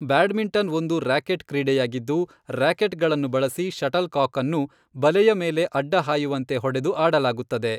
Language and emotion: Kannada, neutral